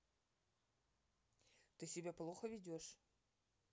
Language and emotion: Russian, neutral